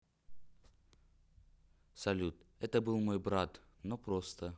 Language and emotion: Russian, neutral